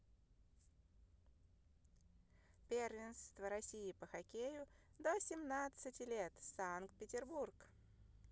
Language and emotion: Russian, positive